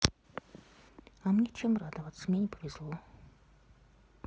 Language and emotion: Russian, sad